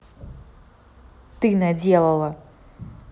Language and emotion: Russian, angry